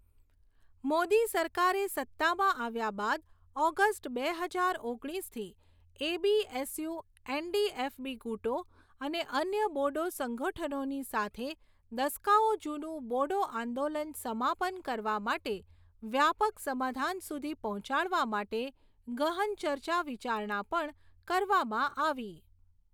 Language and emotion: Gujarati, neutral